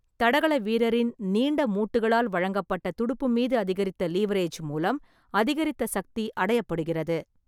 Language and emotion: Tamil, neutral